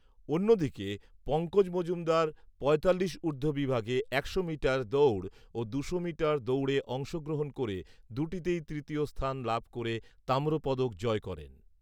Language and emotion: Bengali, neutral